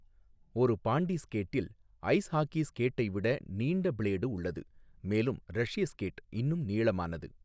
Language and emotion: Tamil, neutral